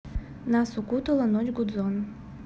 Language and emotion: Russian, neutral